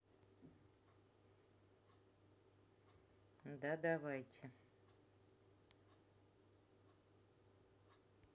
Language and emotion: Russian, neutral